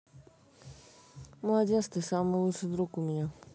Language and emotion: Russian, neutral